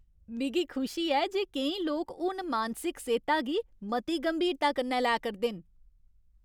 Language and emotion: Dogri, happy